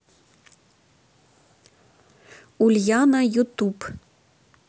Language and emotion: Russian, neutral